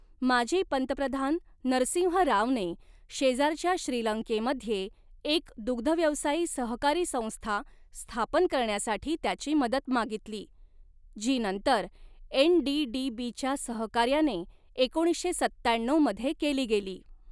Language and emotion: Marathi, neutral